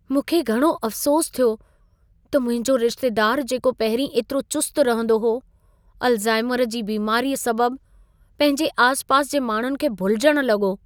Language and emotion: Sindhi, sad